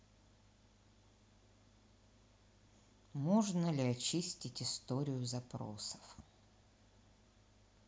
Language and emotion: Russian, neutral